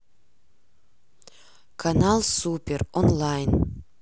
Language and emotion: Russian, neutral